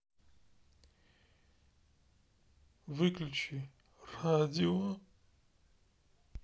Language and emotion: Russian, sad